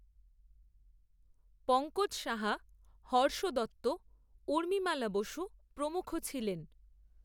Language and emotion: Bengali, neutral